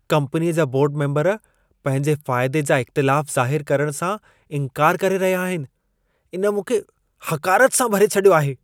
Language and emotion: Sindhi, disgusted